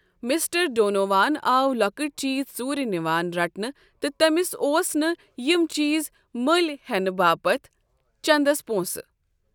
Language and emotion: Kashmiri, neutral